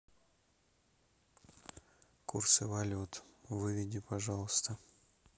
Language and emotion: Russian, neutral